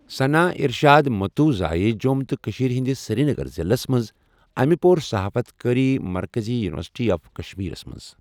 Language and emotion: Kashmiri, neutral